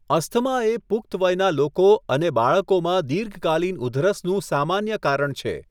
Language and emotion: Gujarati, neutral